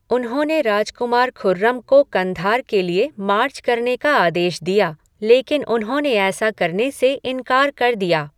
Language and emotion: Hindi, neutral